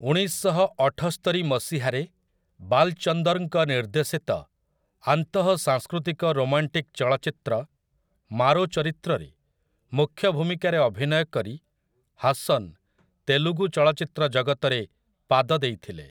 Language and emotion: Odia, neutral